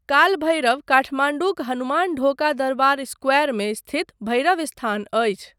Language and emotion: Maithili, neutral